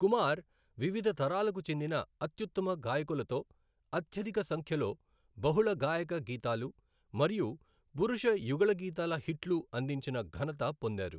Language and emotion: Telugu, neutral